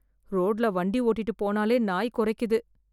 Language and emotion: Tamil, fearful